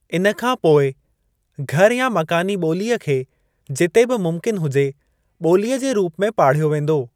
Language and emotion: Sindhi, neutral